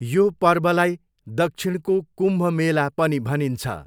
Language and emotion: Nepali, neutral